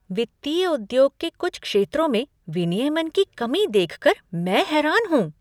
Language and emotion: Hindi, surprised